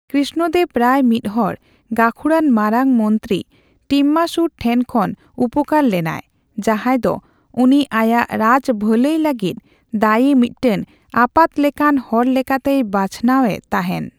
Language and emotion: Santali, neutral